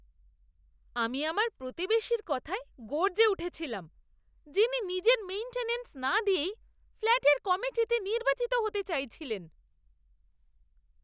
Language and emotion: Bengali, disgusted